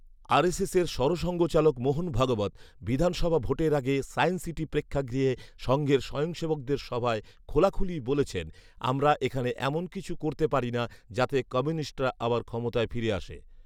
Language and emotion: Bengali, neutral